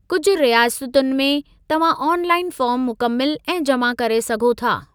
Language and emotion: Sindhi, neutral